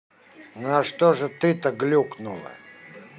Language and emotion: Russian, angry